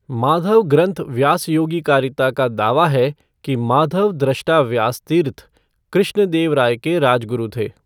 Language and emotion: Hindi, neutral